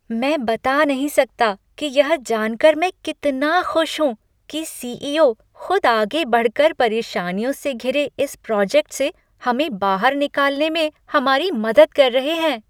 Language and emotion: Hindi, happy